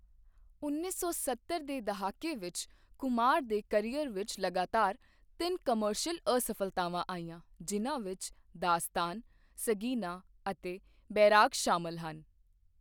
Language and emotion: Punjabi, neutral